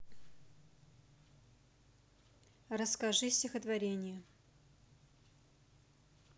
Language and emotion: Russian, neutral